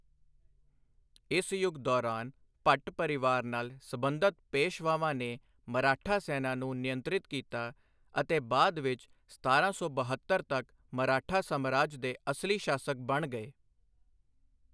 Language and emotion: Punjabi, neutral